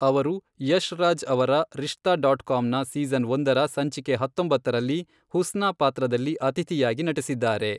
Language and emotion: Kannada, neutral